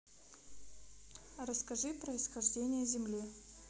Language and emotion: Russian, neutral